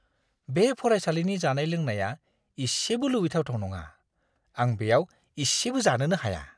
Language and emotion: Bodo, disgusted